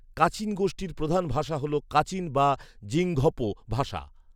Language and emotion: Bengali, neutral